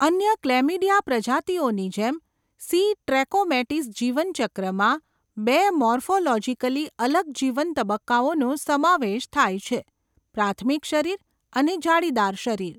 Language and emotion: Gujarati, neutral